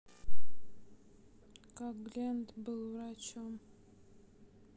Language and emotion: Russian, sad